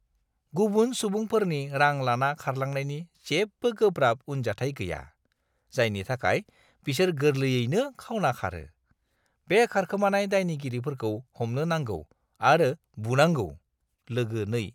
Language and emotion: Bodo, disgusted